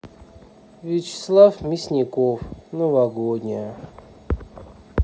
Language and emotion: Russian, sad